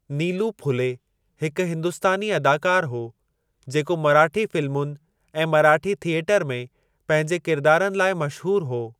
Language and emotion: Sindhi, neutral